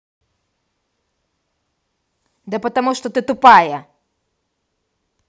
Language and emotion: Russian, angry